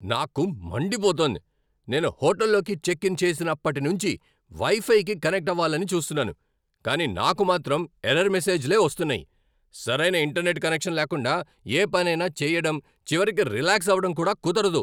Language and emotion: Telugu, angry